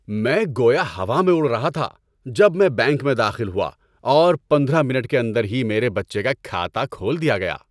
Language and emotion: Urdu, happy